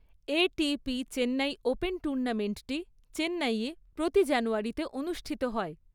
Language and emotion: Bengali, neutral